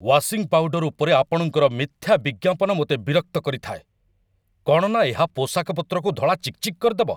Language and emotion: Odia, angry